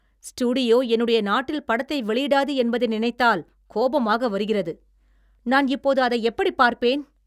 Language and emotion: Tamil, angry